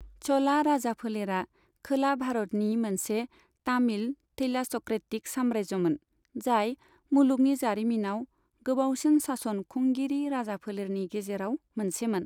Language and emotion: Bodo, neutral